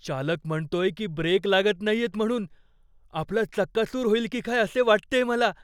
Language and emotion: Marathi, fearful